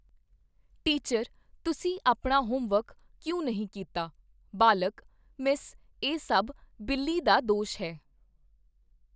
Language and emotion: Punjabi, neutral